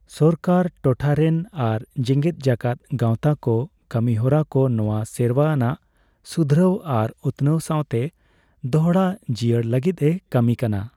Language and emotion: Santali, neutral